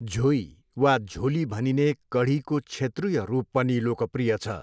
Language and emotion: Nepali, neutral